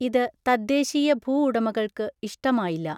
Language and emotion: Malayalam, neutral